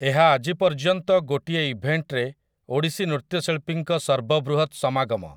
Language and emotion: Odia, neutral